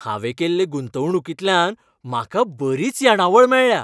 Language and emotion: Goan Konkani, happy